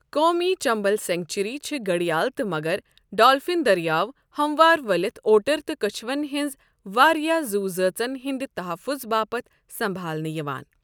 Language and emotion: Kashmiri, neutral